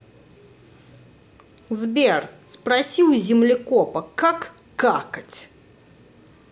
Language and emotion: Russian, angry